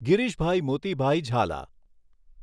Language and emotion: Gujarati, neutral